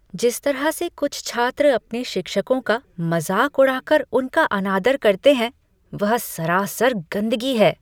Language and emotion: Hindi, disgusted